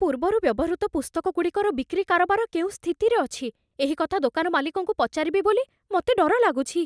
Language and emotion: Odia, fearful